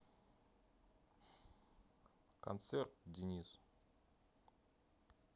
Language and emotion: Russian, neutral